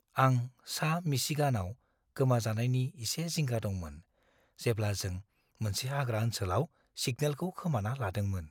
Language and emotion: Bodo, fearful